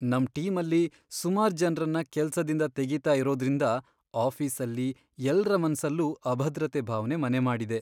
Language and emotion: Kannada, sad